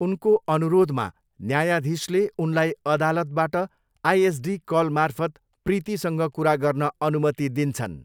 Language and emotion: Nepali, neutral